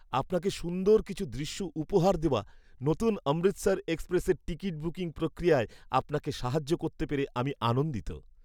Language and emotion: Bengali, happy